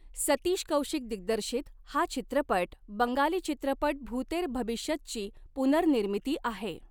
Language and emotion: Marathi, neutral